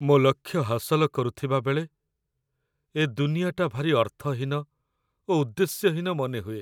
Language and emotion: Odia, sad